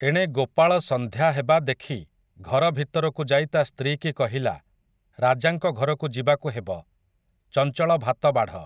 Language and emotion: Odia, neutral